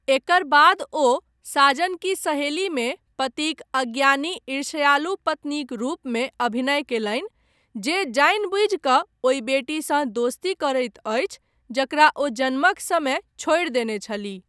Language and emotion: Maithili, neutral